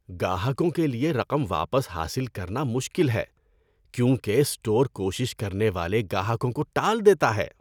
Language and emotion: Urdu, disgusted